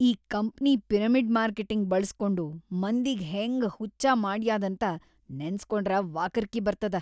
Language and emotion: Kannada, disgusted